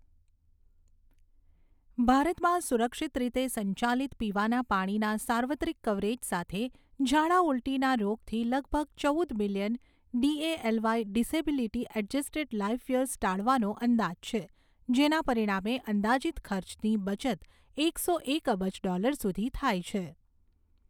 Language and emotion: Gujarati, neutral